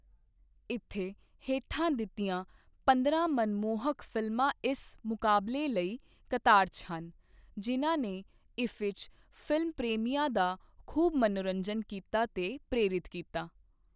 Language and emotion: Punjabi, neutral